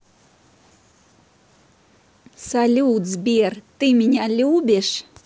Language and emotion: Russian, positive